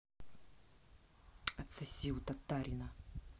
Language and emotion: Russian, angry